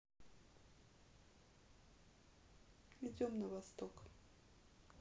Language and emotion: Russian, neutral